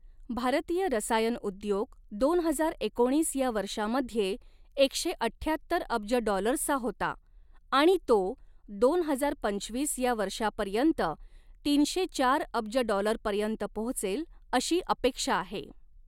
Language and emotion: Marathi, neutral